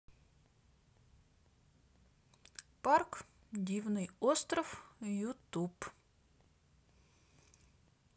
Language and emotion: Russian, neutral